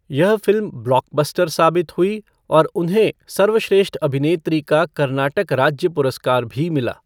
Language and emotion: Hindi, neutral